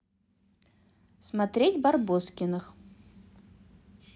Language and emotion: Russian, positive